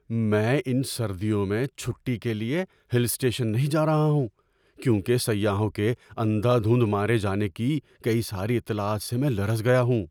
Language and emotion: Urdu, fearful